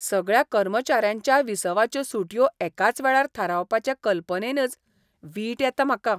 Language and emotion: Goan Konkani, disgusted